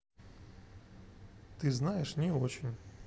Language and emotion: Russian, neutral